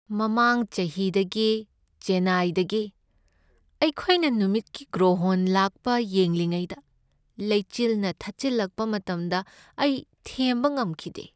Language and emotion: Manipuri, sad